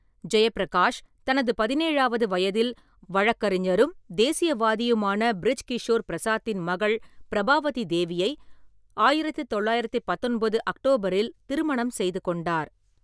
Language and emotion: Tamil, neutral